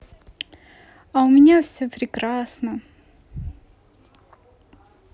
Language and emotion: Russian, positive